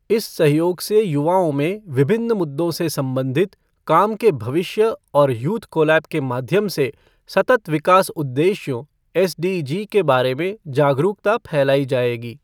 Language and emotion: Hindi, neutral